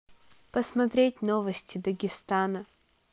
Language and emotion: Russian, neutral